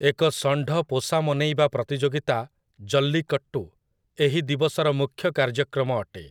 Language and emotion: Odia, neutral